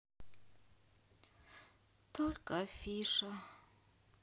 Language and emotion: Russian, sad